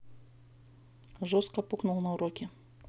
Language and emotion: Russian, neutral